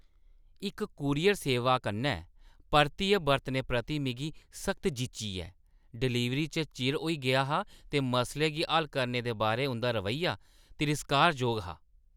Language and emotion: Dogri, disgusted